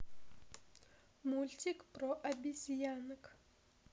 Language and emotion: Russian, neutral